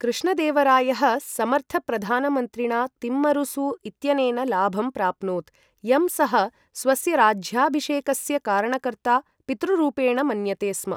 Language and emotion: Sanskrit, neutral